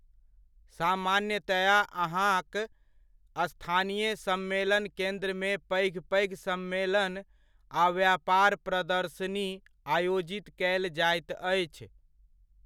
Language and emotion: Maithili, neutral